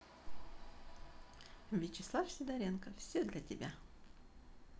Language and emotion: Russian, positive